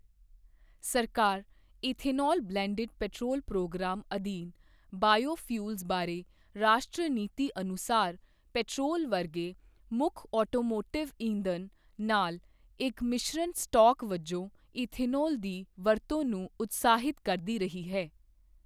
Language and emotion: Punjabi, neutral